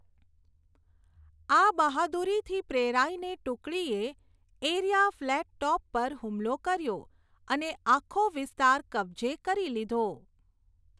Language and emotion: Gujarati, neutral